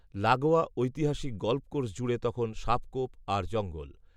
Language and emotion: Bengali, neutral